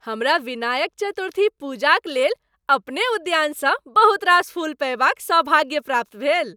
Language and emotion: Maithili, happy